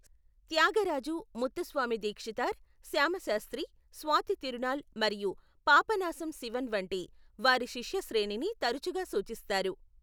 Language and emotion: Telugu, neutral